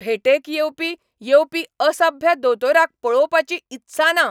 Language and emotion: Goan Konkani, angry